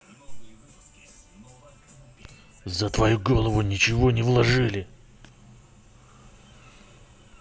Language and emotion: Russian, angry